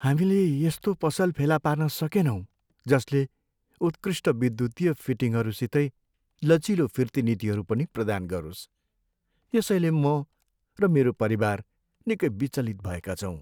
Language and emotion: Nepali, sad